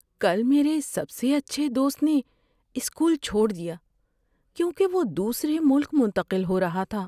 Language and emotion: Urdu, sad